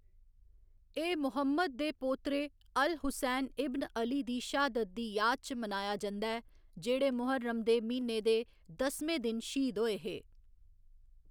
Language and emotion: Dogri, neutral